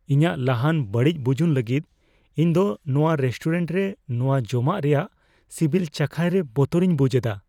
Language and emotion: Santali, fearful